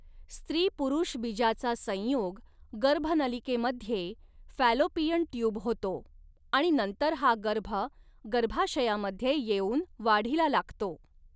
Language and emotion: Marathi, neutral